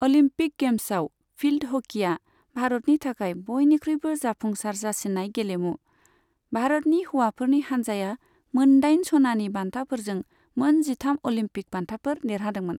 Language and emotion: Bodo, neutral